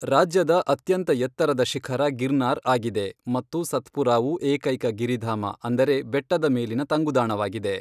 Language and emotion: Kannada, neutral